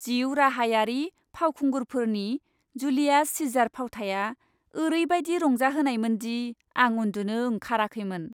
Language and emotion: Bodo, happy